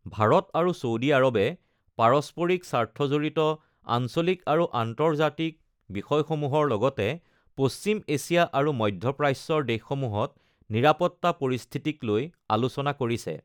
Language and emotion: Assamese, neutral